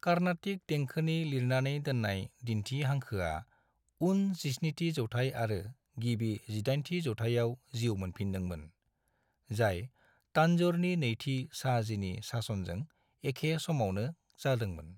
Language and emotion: Bodo, neutral